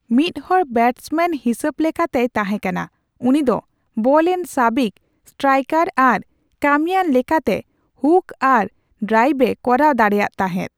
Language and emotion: Santali, neutral